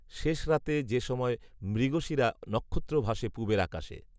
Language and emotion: Bengali, neutral